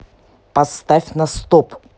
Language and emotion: Russian, angry